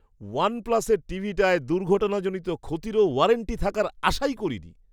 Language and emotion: Bengali, surprised